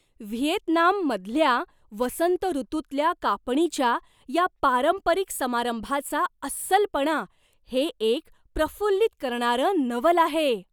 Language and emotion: Marathi, surprised